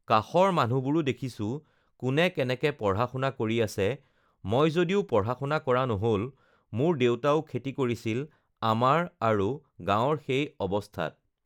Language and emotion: Assamese, neutral